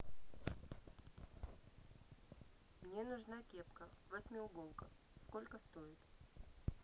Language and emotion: Russian, neutral